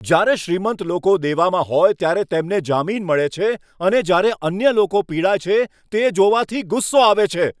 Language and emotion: Gujarati, angry